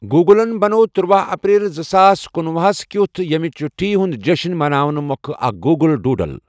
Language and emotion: Kashmiri, neutral